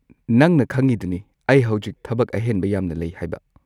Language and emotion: Manipuri, neutral